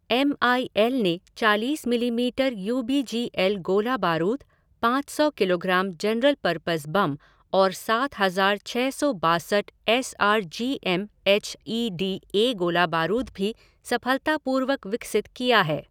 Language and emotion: Hindi, neutral